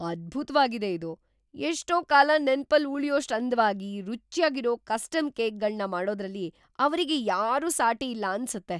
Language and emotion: Kannada, surprised